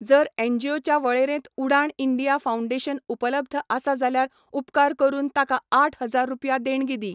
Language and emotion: Goan Konkani, neutral